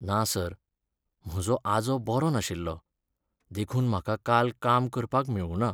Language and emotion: Goan Konkani, sad